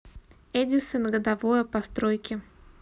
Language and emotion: Russian, neutral